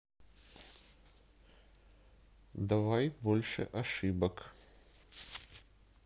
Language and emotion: Russian, neutral